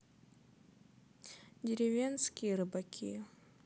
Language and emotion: Russian, sad